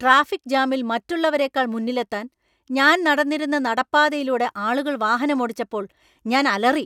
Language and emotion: Malayalam, angry